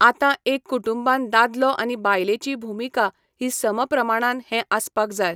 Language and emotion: Goan Konkani, neutral